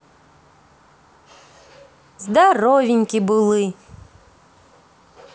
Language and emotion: Russian, positive